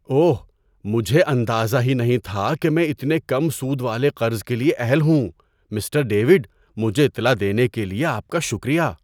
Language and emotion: Urdu, surprised